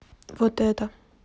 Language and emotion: Russian, neutral